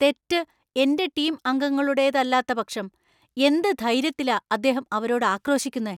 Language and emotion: Malayalam, angry